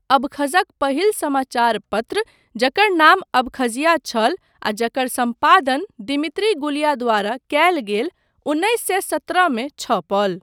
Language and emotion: Maithili, neutral